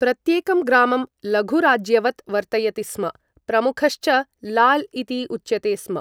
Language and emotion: Sanskrit, neutral